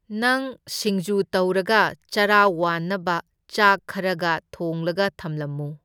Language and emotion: Manipuri, neutral